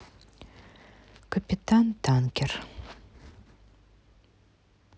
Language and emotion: Russian, neutral